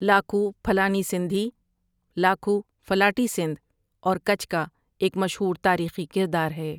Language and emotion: Urdu, neutral